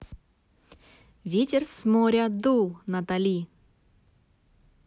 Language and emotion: Russian, neutral